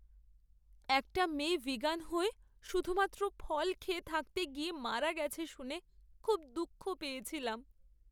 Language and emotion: Bengali, sad